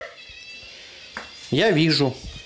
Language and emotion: Russian, neutral